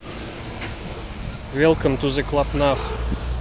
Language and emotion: Russian, neutral